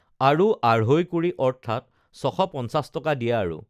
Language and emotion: Assamese, neutral